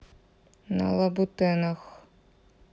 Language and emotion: Russian, neutral